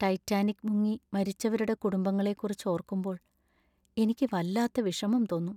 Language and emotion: Malayalam, sad